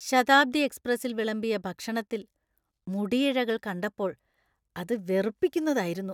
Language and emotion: Malayalam, disgusted